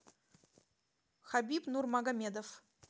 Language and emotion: Russian, neutral